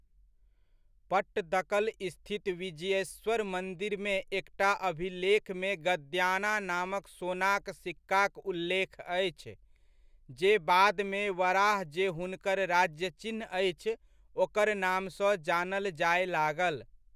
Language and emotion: Maithili, neutral